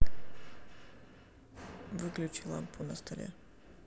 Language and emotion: Russian, neutral